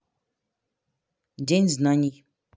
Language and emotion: Russian, neutral